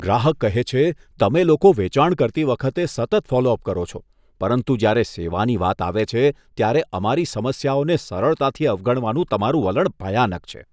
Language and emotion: Gujarati, disgusted